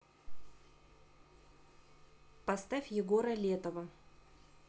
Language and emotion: Russian, neutral